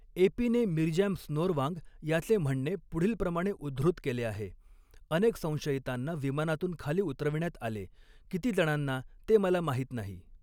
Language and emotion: Marathi, neutral